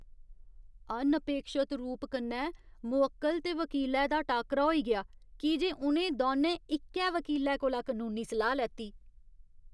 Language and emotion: Dogri, disgusted